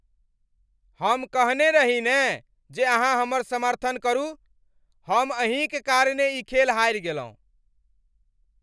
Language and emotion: Maithili, angry